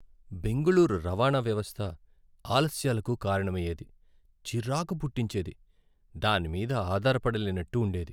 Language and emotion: Telugu, sad